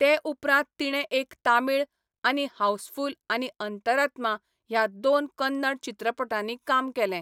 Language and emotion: Goan Konkani, neutral